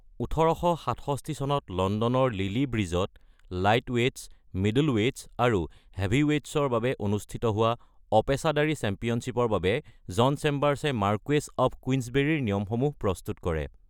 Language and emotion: Assamese, neutral